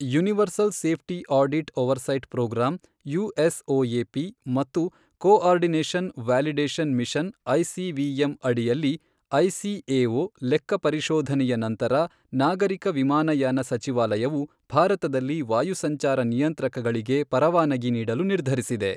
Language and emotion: Kannada, neutral